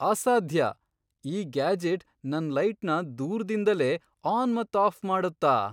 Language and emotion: Kannada, surprised